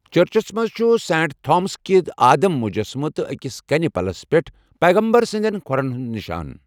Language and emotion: Kashmiri, neutral